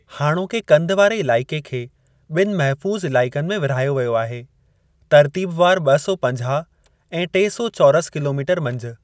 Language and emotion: Sindhi, neutral